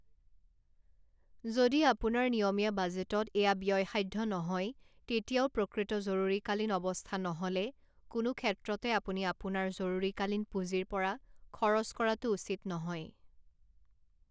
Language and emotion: Assamese, neutral